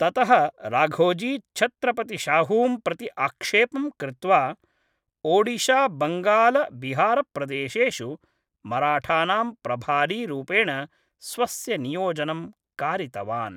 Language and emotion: Sanskrit, neutral